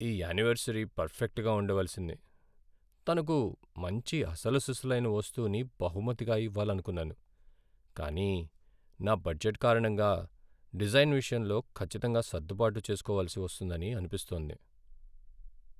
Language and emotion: Telugu, sad